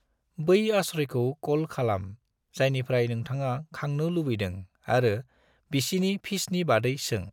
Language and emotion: Bodo, neutral